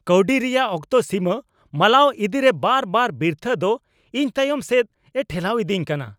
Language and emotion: Santali, angry